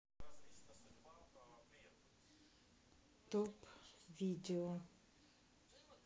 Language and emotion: Russian, neutral